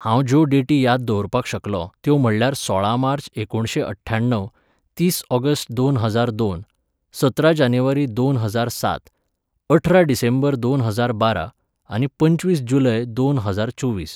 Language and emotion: Goan Konkani, neutral